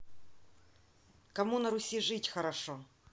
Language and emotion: Russian, neutral